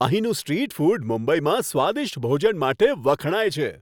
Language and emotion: Gujarati, happy